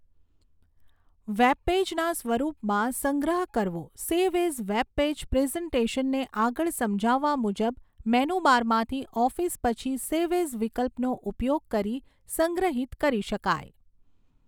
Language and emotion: Gujarati, neutral